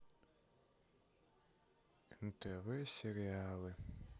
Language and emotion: Russian, sad